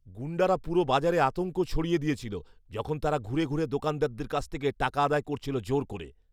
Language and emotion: Bengali, fearful